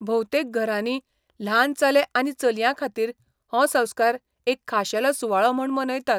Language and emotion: Goan Konkani, neutral